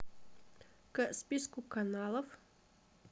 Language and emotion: Russian, neutral